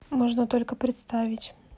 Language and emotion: Russian, neutral